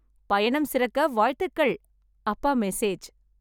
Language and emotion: Tamil, happy